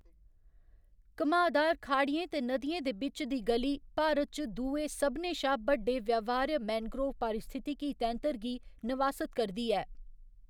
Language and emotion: Dogri, neutral